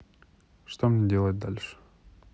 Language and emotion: Russian, neutral